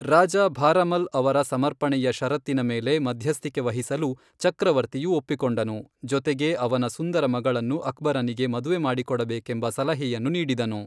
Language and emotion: Kannada, neutral